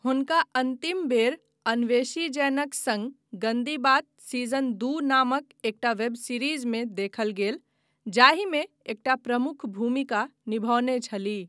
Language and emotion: Maithili, neutral